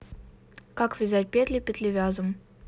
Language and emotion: Russian, neutral